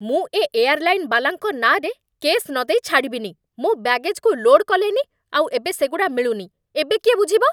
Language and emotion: Odia, angry